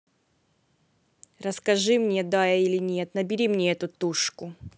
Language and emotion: Russian, neutral